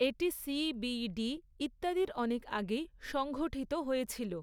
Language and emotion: Bengali, neutral